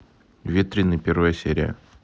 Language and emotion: Russian, neutral